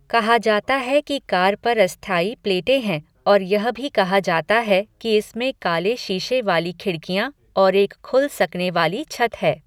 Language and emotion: Hindi, neutral